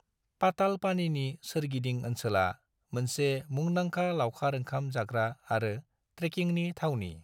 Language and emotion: Bodo, neutral